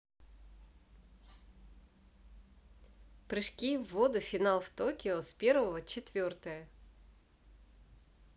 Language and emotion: Russian, positive